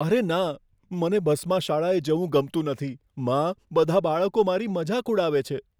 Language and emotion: Gujarati, fearful